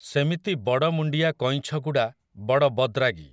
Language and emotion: Odia, neutral